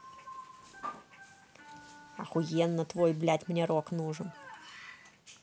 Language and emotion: Russian, angry